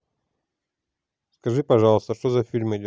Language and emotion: Russian, neutral